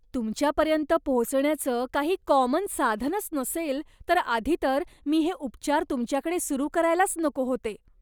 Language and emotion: Marathi, disgusted